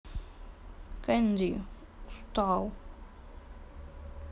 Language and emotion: Russian, sad